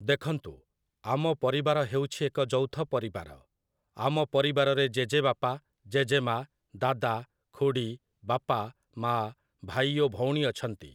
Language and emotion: Odia, neutral